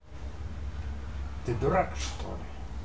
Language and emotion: Russian, angry